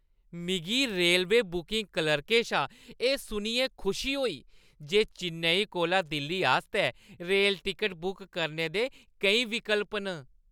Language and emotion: Dogri, happy